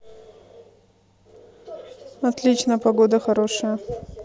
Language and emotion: Russian, neutral